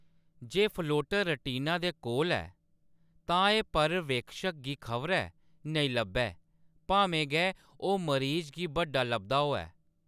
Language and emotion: Dogri, neutral